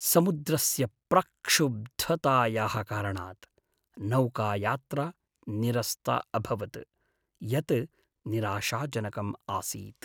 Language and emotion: Sanskrit, sad